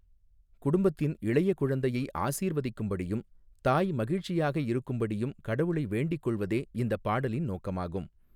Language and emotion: Tamil, neutral